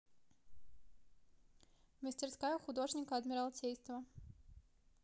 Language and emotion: Russian, neutral